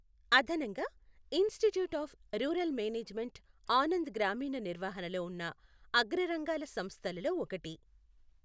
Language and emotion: Telugu, neutral